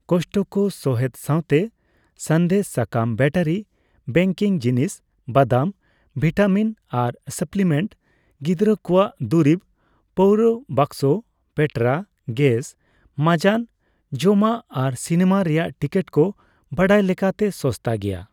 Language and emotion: Santali, neutral